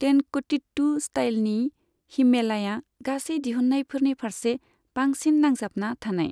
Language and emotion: Bodo, neutral